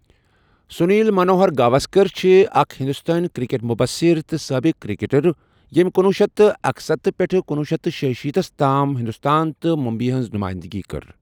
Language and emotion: Kashmiri, neutral